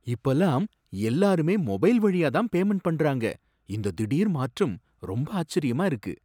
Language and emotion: Tamil, surprised